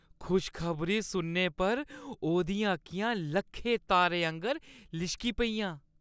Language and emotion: Dogri, happy